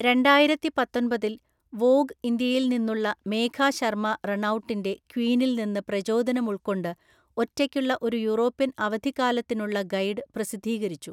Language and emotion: Malayalam, neutral